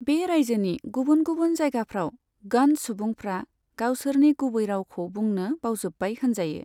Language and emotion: Bodo, neutral